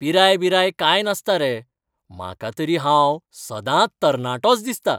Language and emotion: Goan Konkani, happy